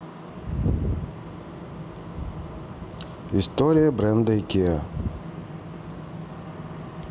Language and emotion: Russian, neutral